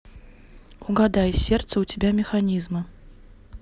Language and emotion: Russian, neutral